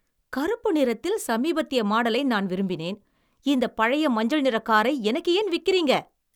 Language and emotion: Tamil, angry